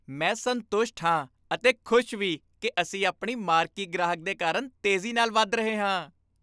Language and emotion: Punjabi, happy